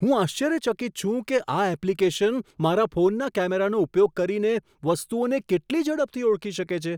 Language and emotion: Gujarati, surprised